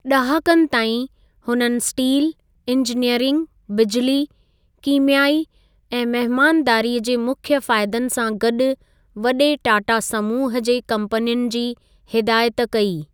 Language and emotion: Sindhi, neutral